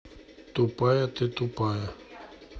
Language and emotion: Russian, neutral